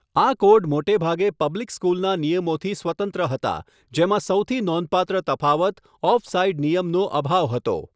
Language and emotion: Gujarati, neutral